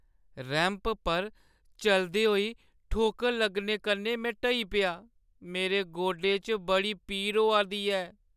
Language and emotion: Dogri, sad